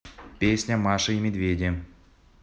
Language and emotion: Russian, neutral